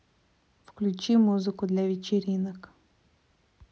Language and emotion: Russian, neutral